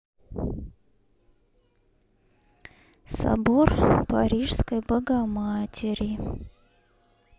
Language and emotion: Russian, neutral